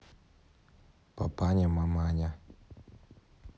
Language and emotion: Russian, neutral